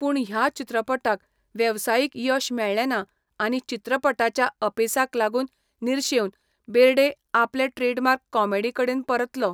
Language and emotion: Goan Konkani, neutral